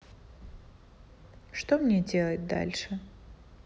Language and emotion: Russian, sad